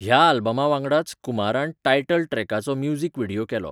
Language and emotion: Goan Konkani, neutral